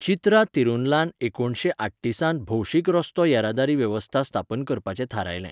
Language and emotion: Goan Konkani, neutral